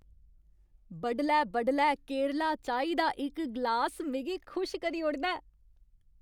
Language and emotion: Dogri, happy